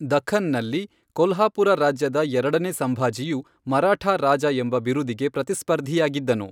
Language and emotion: Kannada, neutral